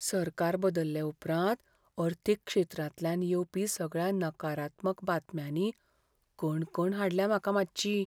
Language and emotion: Goan Konkani, fearful